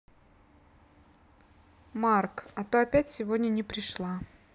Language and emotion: Russian, neutral